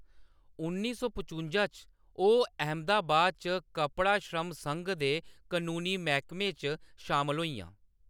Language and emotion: Dogri, neutral